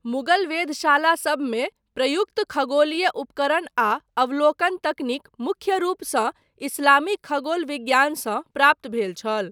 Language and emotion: Maithili, neutral